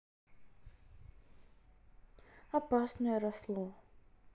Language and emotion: Russian, sad